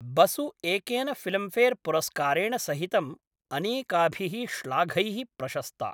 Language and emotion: Sanskrit, neutral